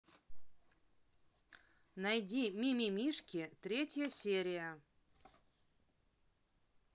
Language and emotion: Russian, neutral